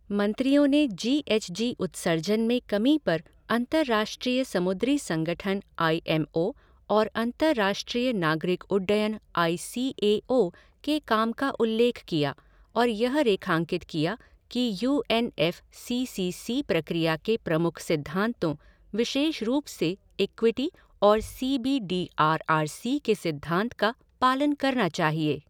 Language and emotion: Hindi, neutral